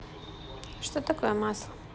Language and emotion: Russian, neutral